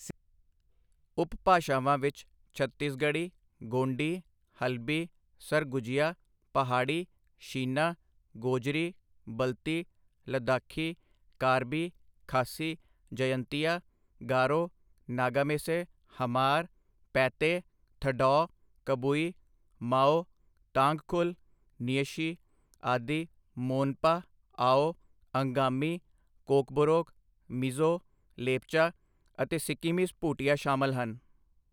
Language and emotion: Punjabi, neutral